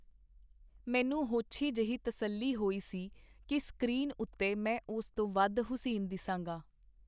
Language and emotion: Punjabi, neutral